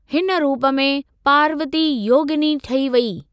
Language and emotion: Sindhi, neutral